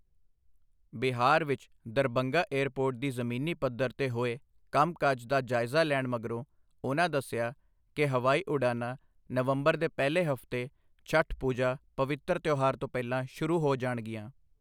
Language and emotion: Punjabi, neutral